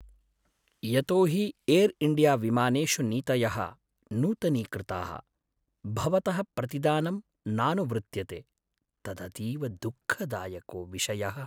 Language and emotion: Sanskrit, sad